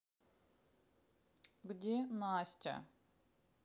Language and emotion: Russian, sad